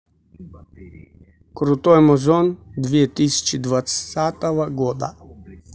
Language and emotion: Russian, neutral